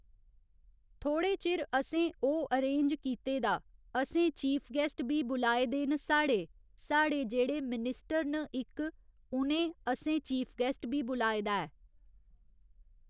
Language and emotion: Dogri, neutral